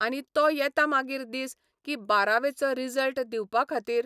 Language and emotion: Goan Konkani, neutral